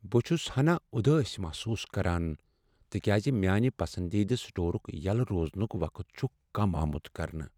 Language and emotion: Kashmiri, sad